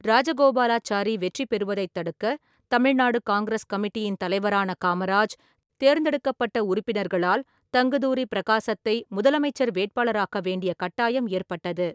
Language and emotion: Tamil, neutral